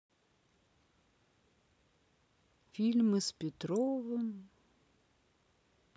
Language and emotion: Russian, sad